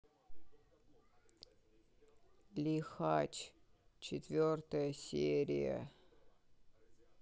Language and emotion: Russian, sad